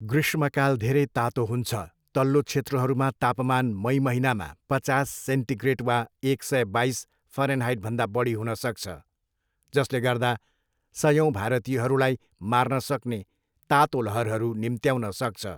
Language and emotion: Nepali, neutral